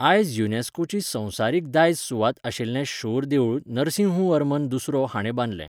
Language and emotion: Goan Konkani, neutral